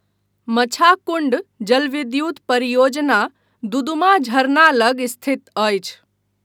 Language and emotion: Maithili, neutral